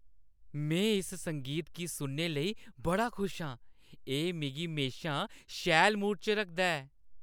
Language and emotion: Dogri, happy